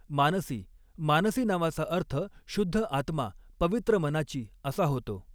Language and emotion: Marathi, neutral